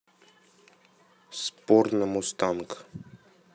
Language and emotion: Russian, neutral